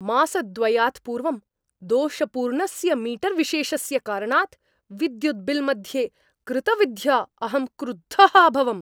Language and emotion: Sanskrit, angry